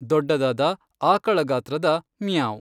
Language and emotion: Kannada, neutral